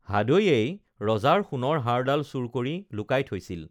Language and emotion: Assamese, neutral